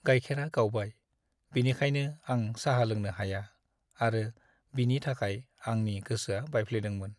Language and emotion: Bodo, sad